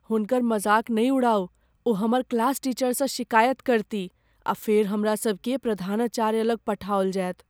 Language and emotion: Maithili, fearful